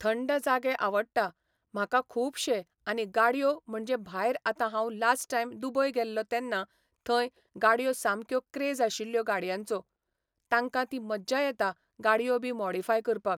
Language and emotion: Goan Konkani, neutral